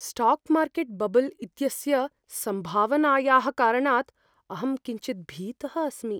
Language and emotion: Sanskrit, fearful